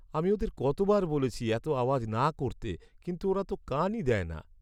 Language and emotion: Bengali, sad